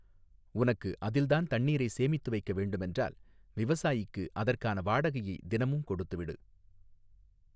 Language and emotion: Tamil, neutral